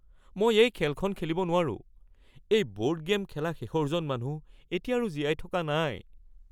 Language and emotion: Assamese, fearful